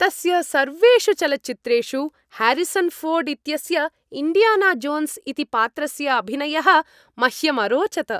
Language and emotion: Sanskrit, happy